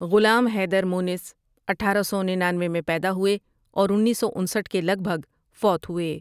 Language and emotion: Urdu, neutral